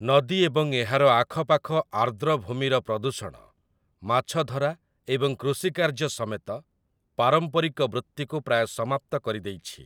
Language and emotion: Odia, neutral